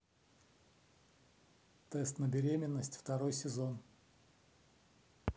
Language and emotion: Russian, neutral